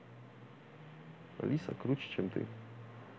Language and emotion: Russian, neutral